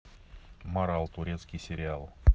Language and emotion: Russian, neutral